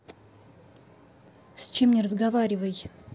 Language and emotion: Russian, angry